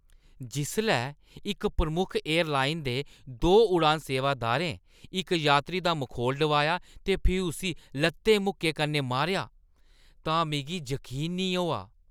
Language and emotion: Dogri, disgusted